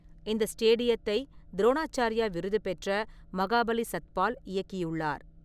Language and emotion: Tamil, neutral